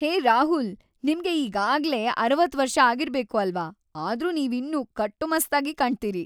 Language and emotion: Kannada, happy